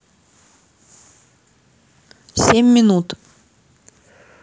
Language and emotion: Russian, neutral